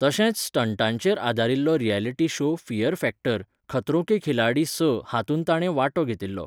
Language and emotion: Goan Konkani, neutral